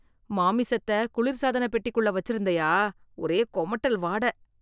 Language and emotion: Tamil, disgusted